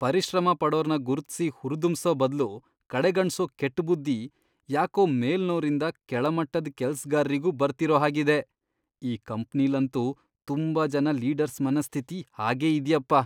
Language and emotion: Kannada, disgusted